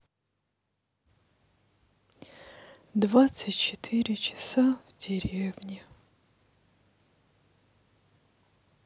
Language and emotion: Russian, sad